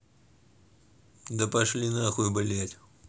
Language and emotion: Russian, angry